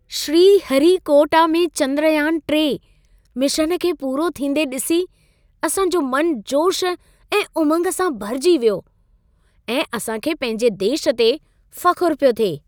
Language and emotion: Sindhi, happy